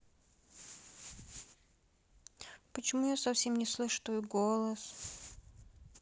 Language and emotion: Russian, sad